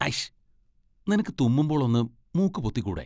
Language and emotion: Malayalam, disgusted